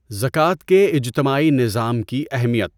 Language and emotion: Urdu, neutral